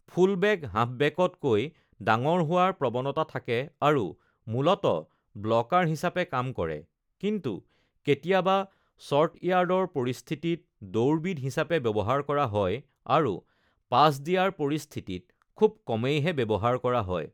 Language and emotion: Assamese, neutral